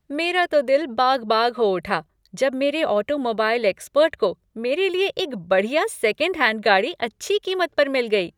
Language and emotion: Hindi, happy